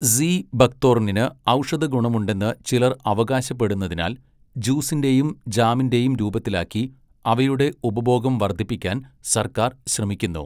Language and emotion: Malayalam, neutral